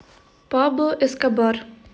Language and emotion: Russian, neutral